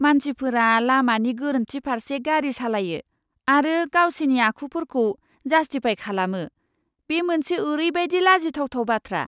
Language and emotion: Bodo, disgusted